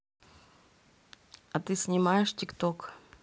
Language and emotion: Russian, neutral